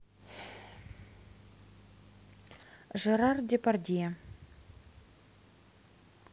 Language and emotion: Russian, neutral